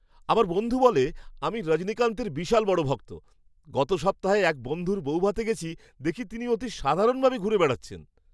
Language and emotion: Bengali, surprised